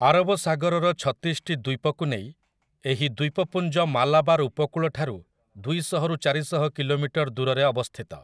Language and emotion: Odia, neutral